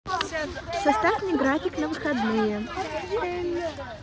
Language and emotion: Russian, neutral